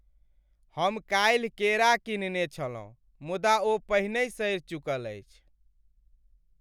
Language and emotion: Maithili, sad